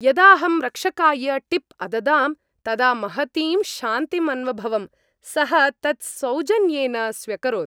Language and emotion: Sanskrit, happy